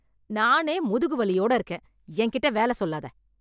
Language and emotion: Tamil, angry